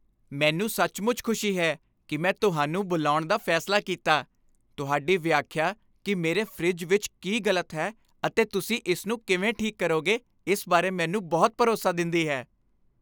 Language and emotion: Punjabi, happy